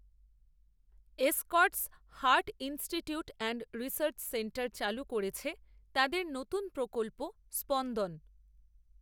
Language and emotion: Bengali, neutral